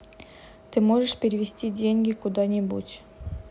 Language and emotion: Russian, neutral